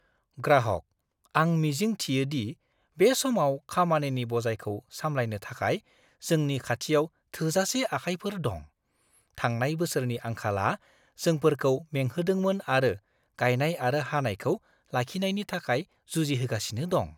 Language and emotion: Bodo, fearful